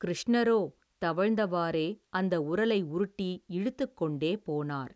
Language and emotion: Tamil, neutral